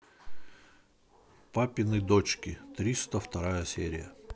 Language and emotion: Russian, neutral